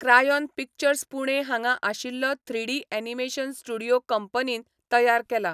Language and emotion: Goan Konkani, neutral